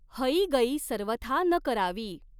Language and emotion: Marathi, neutral